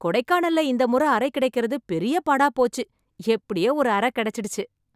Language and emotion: Tamil, happy